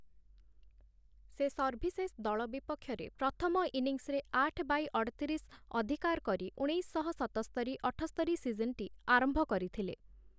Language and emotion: Odia, neutral